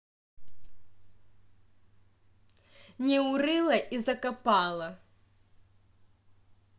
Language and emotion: Russian, angry